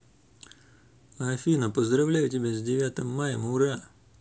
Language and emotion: Russian, neutral